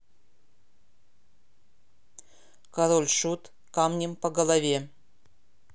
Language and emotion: Russian, neutral